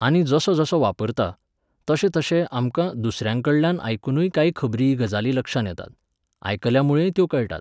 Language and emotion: Goan Konkani, neutral